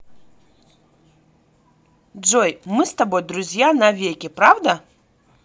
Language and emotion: Russian, positive